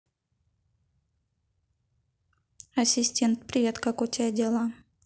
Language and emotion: Russian, neutral